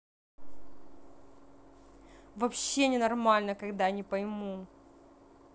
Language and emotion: Russian, angry